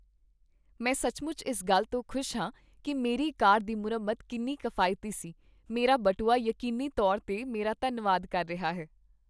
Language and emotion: Punjabi, happy